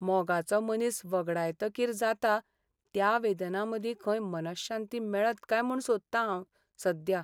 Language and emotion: Goan Konkani, sad